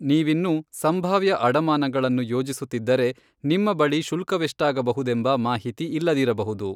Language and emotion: Kannada, neutral